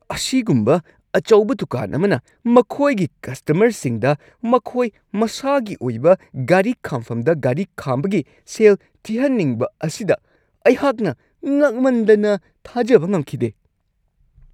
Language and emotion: Manipuri, angry